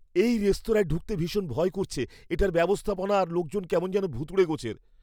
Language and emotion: Bengali, fearful